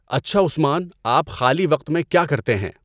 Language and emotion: Urdu, neutral